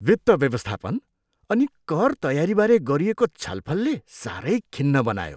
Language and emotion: Nepali, disgusted